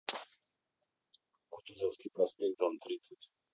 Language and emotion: Russian, neutral